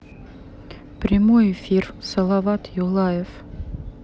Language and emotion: Russian, neutral